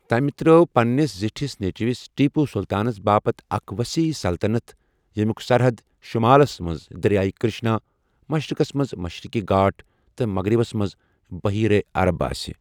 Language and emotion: Kashmiri, neutral